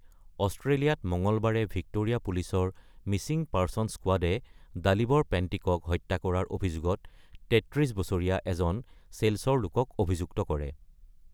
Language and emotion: Assamese, neutral